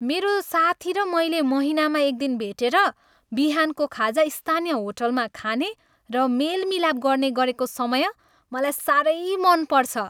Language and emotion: Nepali, happy